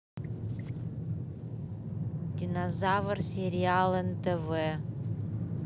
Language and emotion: Russian, neutral